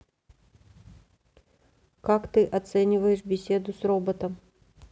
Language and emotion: Russian, neutral